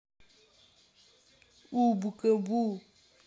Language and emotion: Russian, neutral